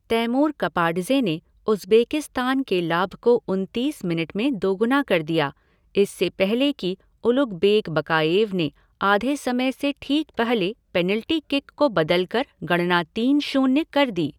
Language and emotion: Hindi, neutral